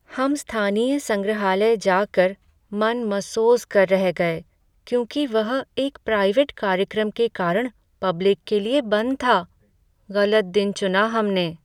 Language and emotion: Hindi, sad